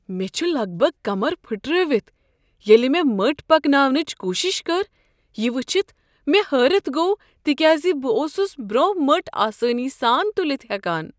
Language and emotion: Kashmiri, surprised